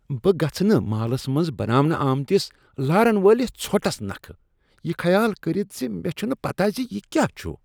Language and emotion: Kashmiri, disgusted